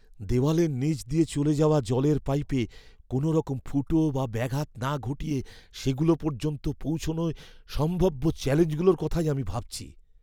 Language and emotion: Bengali, fearful